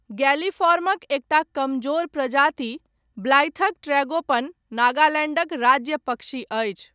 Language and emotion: Maithili, neutral